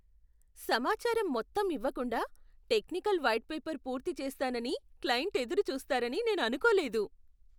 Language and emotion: Telugu, surprised